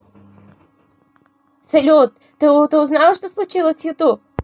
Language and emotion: Russian, positive